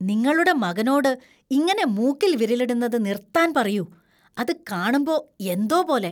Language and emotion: Malayalam, disgusted